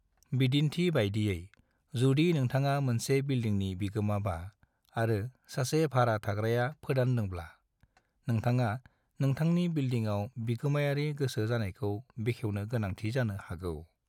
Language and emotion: Bodo, neutral